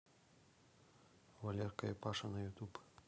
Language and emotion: Russian, neutral